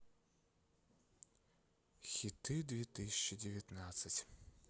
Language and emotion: Russian, sad